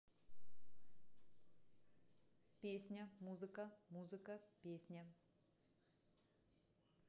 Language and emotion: Russian, neutral